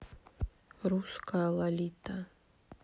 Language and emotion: Russian, sad